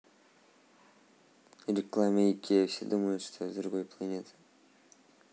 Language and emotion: Russian, neutral